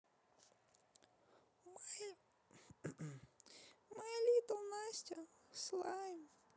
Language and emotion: Russian, sad